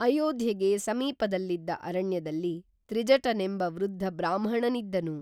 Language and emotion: Kannada, neutral